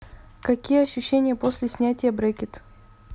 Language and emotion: Russian, neutral